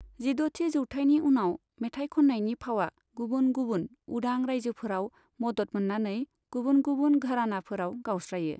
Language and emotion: Bodo, neutral